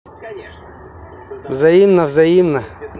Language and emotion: Russian, positive